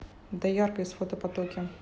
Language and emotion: Russian, neutral